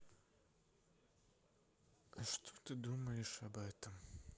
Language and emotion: Russian, neutral